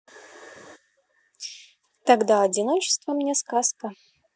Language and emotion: Russian, positive